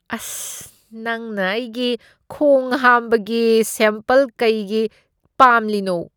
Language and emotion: Manipuri, disgusted